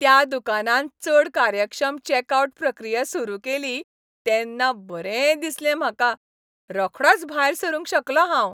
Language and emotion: Goan Konkani, happy